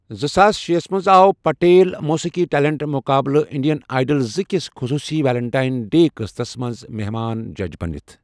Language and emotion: Kashmiri, neutral